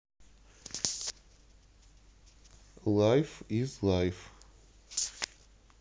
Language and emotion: Russian, neutral